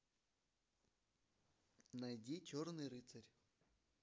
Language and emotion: Russian, neutral